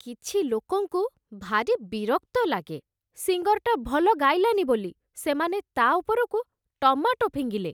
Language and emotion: Odia, disgusted